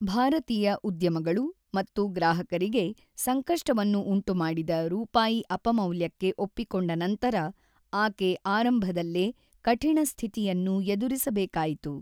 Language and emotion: Kannada, neutral